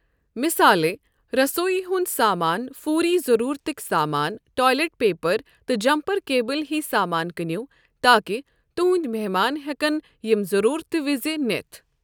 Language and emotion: Kashmiri, neutral